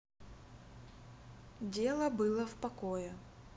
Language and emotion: Russian, neutral